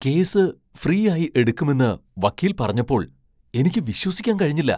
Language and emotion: Malayalam, surprised